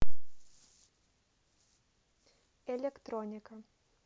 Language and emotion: Russian, neutral